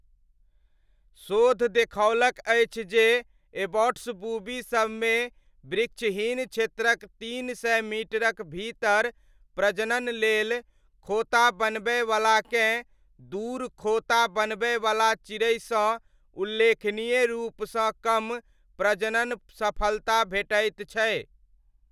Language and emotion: Maithili, neutral